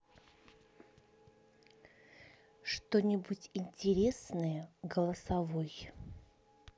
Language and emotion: Russian, neutral